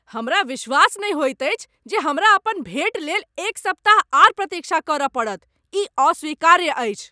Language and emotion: Maithili, angry